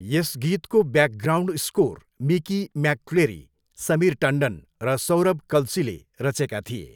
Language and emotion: Nepali, neutral